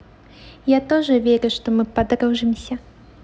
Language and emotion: Russian, neutral